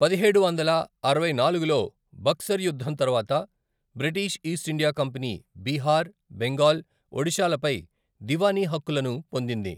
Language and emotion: Telugu, neutral